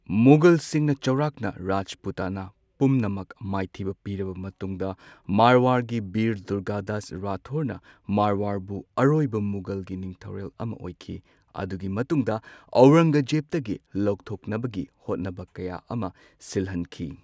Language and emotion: Manipuri, neutral